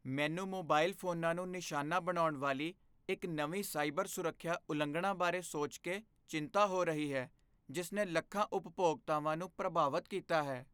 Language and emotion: Punjabi, fearful